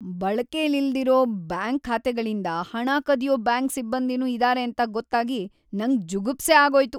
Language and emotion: Kannada, disgusted